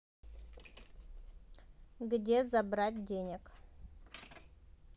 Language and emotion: Russian, neutral